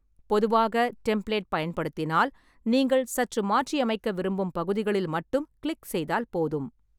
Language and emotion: Tamil, neutral